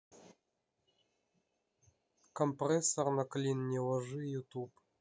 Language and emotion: Russian, neutral